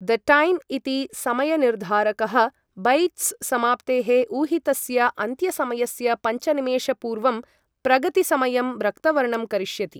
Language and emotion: Sanskrit, neutral